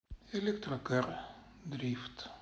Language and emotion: Russian, sad